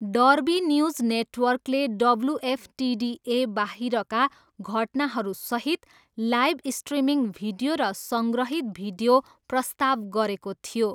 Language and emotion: Nepali, neutral